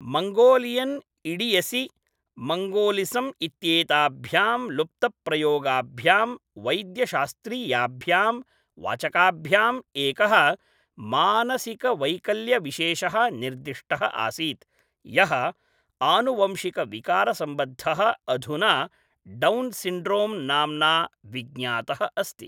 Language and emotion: Sanskrit, neutral